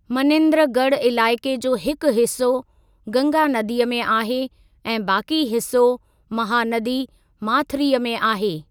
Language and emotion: Sindhi, neutral